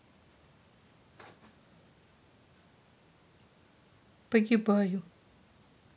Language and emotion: Russian, sad